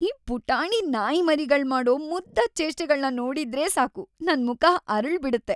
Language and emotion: Kannada, happy